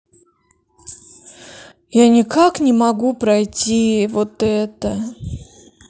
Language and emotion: Russian, sad